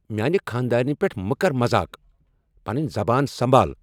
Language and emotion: Kashmiri, angry